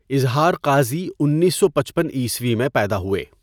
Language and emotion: Urdu, neutral